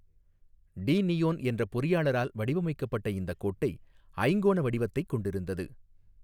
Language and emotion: Tamil, neutral